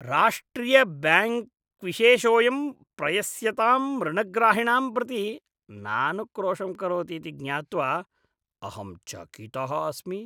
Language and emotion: Sanskrit, disgusted